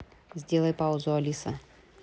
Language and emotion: Russian, neutral